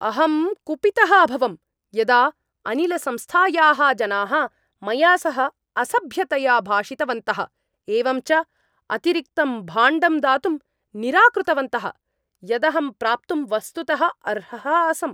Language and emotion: Sanskrit, angry